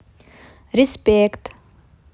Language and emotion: Russian, positive